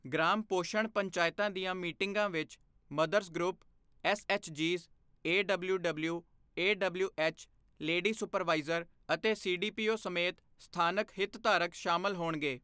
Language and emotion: Punjabi, neutral